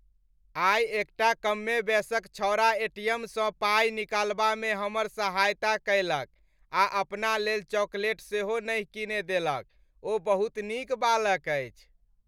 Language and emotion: Maithili, happy